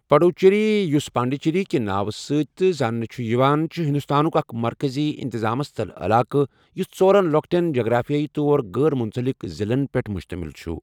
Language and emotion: Kashmiri, neutral